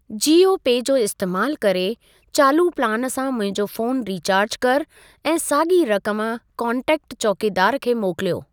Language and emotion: Sindhi, neutral